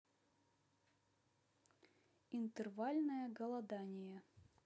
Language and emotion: Russian, neutral